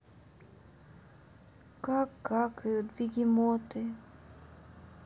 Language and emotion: Russian, sad